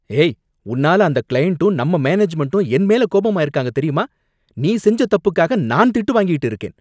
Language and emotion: Tamil, angry